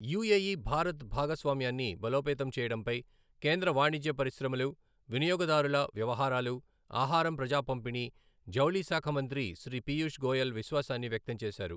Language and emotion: Telugu, neutral